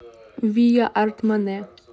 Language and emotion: Russian, neutral